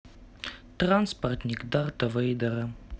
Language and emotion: Russian, neutral